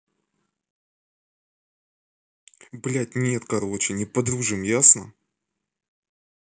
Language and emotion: Russian, angry